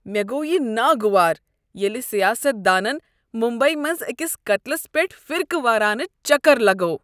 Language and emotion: Kashmiri, disgusted